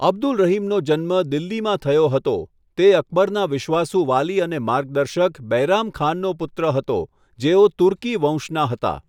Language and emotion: Gujarati, neutral